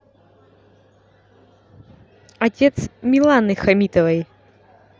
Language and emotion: Russian, neutral